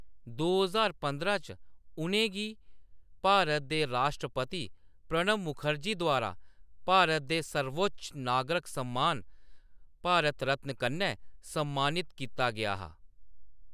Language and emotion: Dogri, neutral